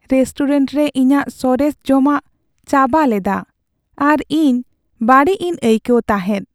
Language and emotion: Santali, sad